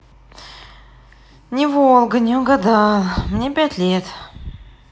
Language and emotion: Russian, sad